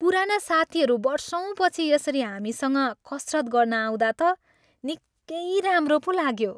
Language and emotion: Nepali, happy